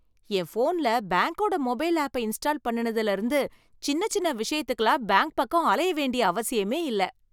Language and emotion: Tamil, happy